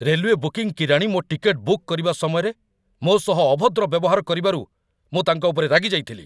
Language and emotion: Odia, angry